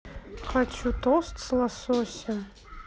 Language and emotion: Russian, neutral